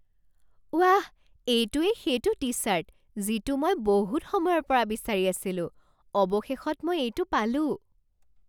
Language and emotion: Assamese, surprised